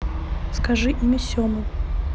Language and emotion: Russian, neutral